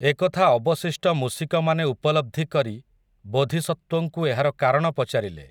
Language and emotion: Odia, neutral